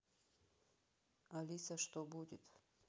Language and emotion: Russian, neutral